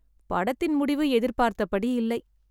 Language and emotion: Tamil, sad